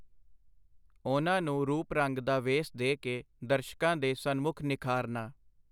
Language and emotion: Punjabi, neutral